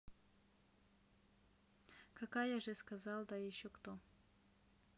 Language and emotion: Russian, neutral